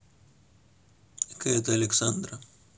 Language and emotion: Russian, neutral